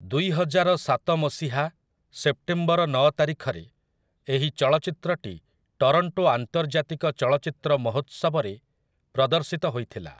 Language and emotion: Odia, neutral